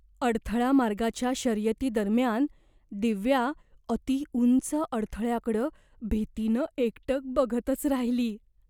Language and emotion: Marathi, fearful